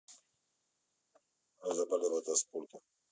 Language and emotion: Russian, neutral